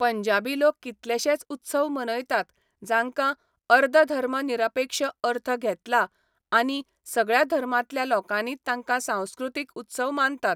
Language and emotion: Goan Konkani, neutral